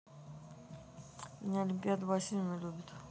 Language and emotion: Russian, neutral